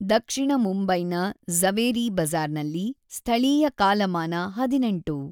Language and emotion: Kannada, neutral